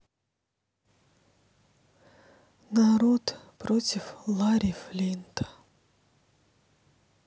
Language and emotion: Russian, sad